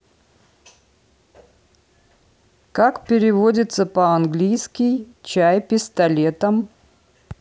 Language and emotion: Russian, neutral